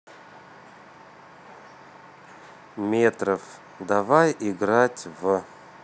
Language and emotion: Russian, neutral